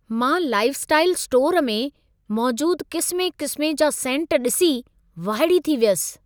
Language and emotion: Sindhi, surprised